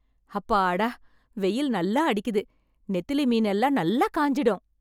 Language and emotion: Tamil, happy